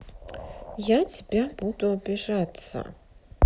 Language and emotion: Russian, neutral